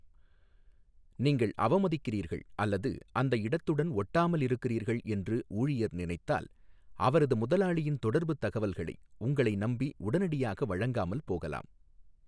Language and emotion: Tamil, neutral